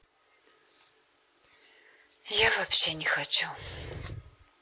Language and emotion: Russian, sad